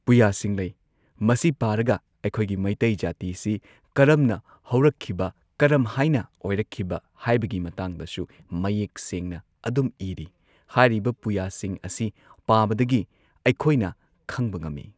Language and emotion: Manipuri, neutral